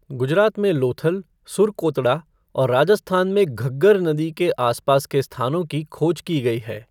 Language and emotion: Hindi, neutral